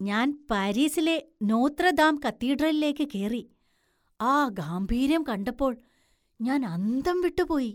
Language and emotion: Malayalam, surprised